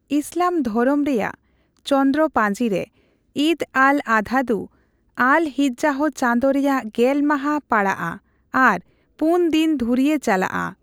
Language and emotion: Santali, neutral